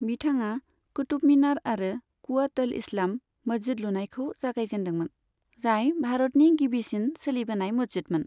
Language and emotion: Bodo, neutral